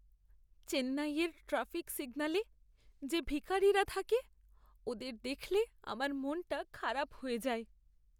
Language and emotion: Bengali, sad